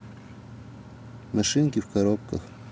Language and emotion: Russian, neutral